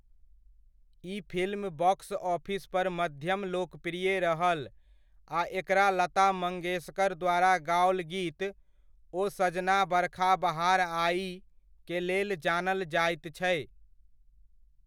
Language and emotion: Maithili, neutral